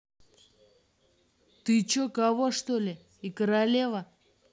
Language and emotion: Russian, angry